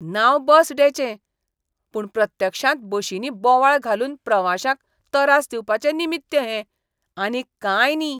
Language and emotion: Goan Konkani, disgusted